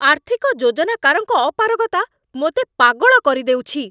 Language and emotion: Odia, angry